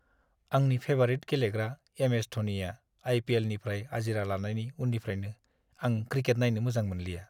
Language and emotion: Bodo, sad